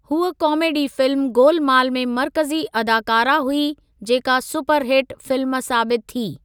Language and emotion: Sindhi, neutral